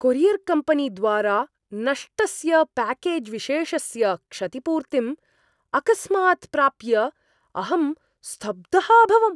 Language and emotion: Sanskrit, surprised